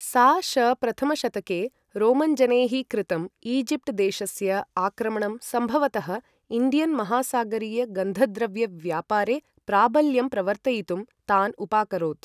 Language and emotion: Sanskrit, neutral